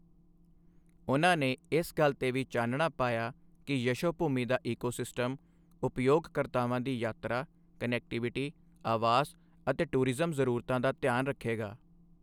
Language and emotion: Punjabi, neutral